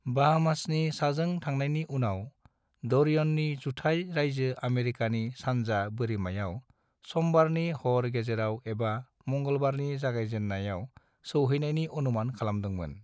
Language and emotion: Bodo, neutral